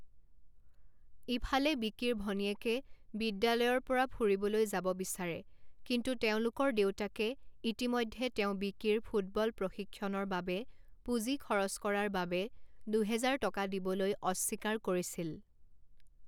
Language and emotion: Assamese, neutral